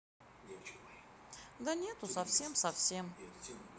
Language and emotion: Russian, neutral